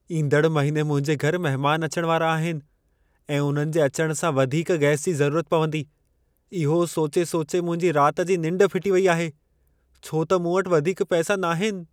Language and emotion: Sindhi, fearful